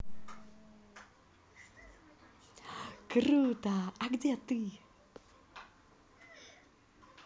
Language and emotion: Russian, positive